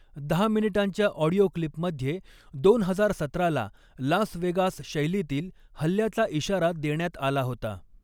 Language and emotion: Marathi, neutral